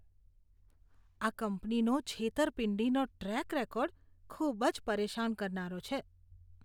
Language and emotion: Gujarati, disgusted